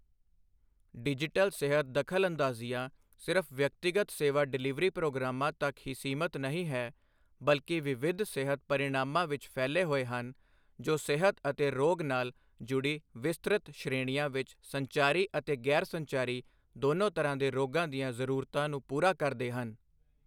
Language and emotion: Punjabi, neutral